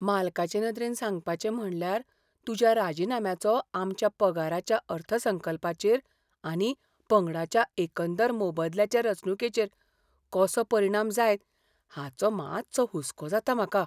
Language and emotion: Goan Konkani, fearful